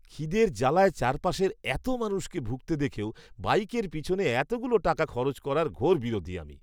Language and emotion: Bengali, disgusted